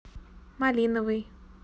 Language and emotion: Russian, neutral